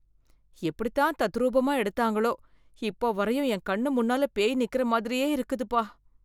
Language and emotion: Tamil, fearful